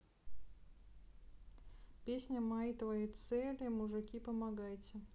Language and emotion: Russian, neutral